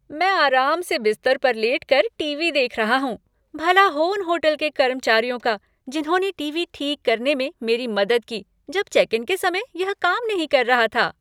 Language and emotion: Hindi, happy